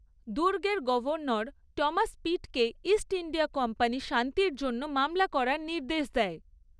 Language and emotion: Bengali, neutral